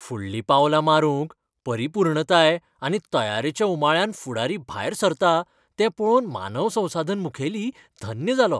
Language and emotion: Goan Konkani, happy